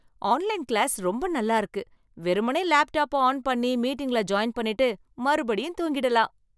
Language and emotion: Tamil, happy